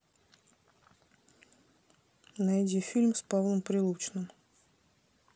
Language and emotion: Russian, neutral